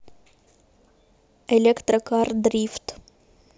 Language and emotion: Russian, neutral